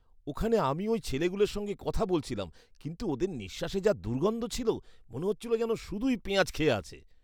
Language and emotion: Bengali, disgusted